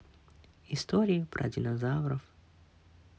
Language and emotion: Russian, sad